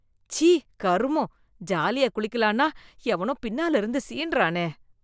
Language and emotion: Tamil, disgusted